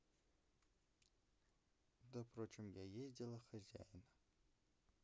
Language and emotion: Russian, neutral